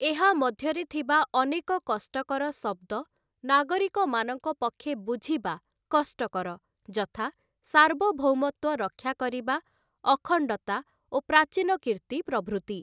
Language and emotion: Odia, neutral